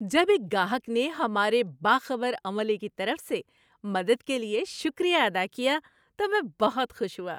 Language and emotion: Urdu, happy